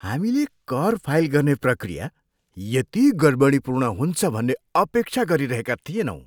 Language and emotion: Nepali, disgusted